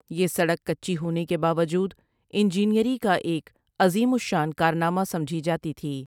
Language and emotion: Urdu, neutral